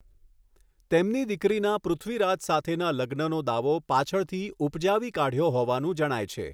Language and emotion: Gujarati, neutral